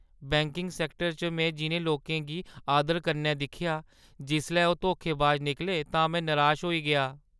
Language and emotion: Dogri, sad